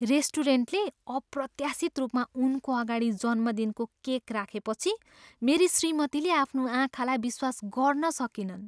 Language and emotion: Nepali, surprised